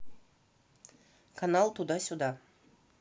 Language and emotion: Russian, neutral